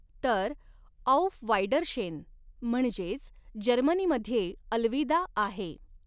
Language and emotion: Marathi, neutral